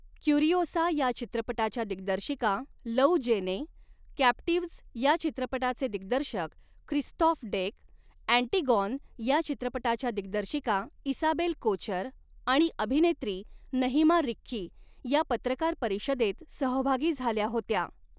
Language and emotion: Marathi, neutral